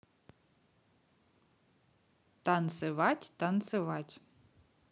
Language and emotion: Russian, positive